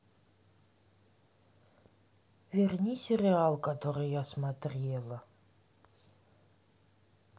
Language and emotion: Russian, sad